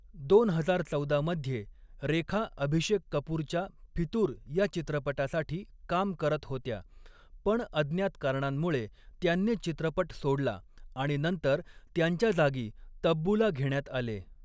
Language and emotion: Marathi, neutral